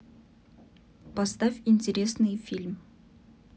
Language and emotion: Russian, neutral